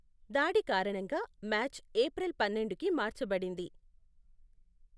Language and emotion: Telugu, neutral